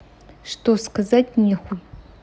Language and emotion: Russian, neutral